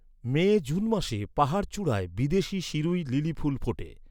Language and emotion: Bengali, neutral